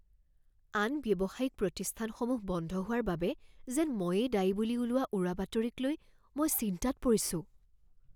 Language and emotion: Assamese, fearful